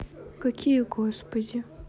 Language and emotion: Russian, sad